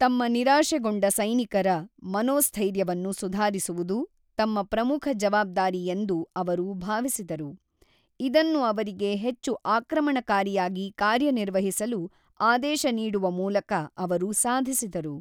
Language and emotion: Kannada, neutral